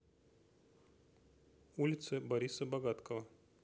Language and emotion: Russian, neutral